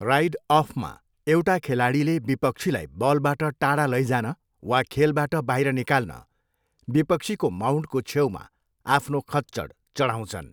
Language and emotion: Nepali, neutral